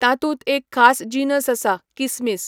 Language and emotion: Goan Konkani, neutral